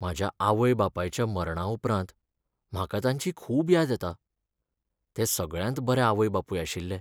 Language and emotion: Goan Konkani, sad